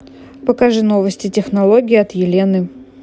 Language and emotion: Russian, neutral